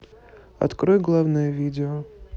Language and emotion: Russian, neutral